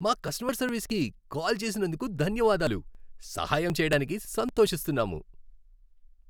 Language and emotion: Telugu, happy